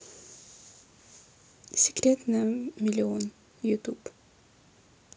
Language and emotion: Russian, neutral